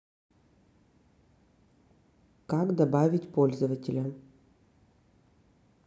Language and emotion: Russian, neutral